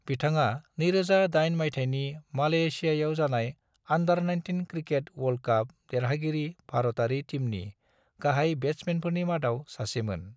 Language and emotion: Bodo, neutral